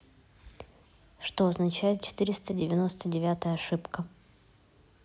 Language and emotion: Russian, neutral